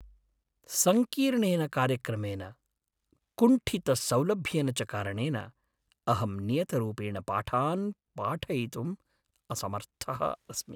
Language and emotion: Sanskrit, sad